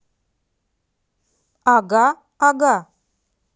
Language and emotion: Russian, neutral